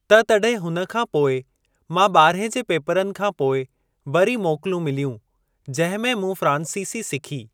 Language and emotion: Sindhi, neutral